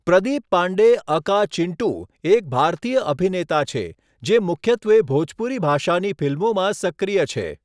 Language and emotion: Gujarati, neutral